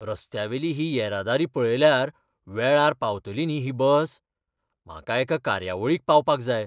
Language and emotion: Goan Konkani, fearful